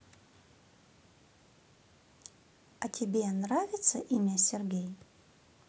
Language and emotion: Russian, positive